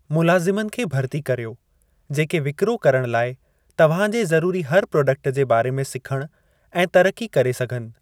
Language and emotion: Sindhi, neutral